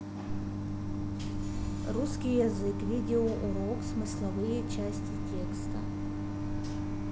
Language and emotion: Russian, neutral